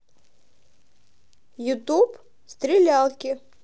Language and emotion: Russian, positive